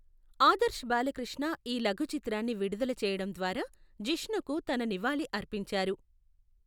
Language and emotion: Telugu, neutral